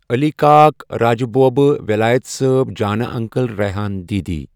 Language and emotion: Kashmiri, neutral